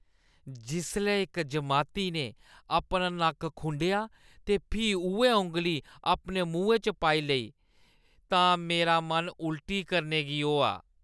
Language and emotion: Dogri, disgusted